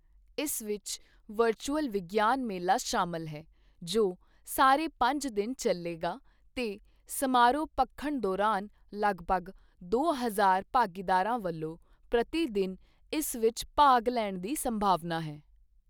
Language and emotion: Punjabi, neutral